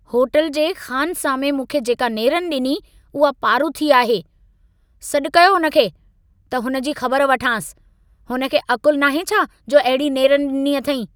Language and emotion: Sindhi, angry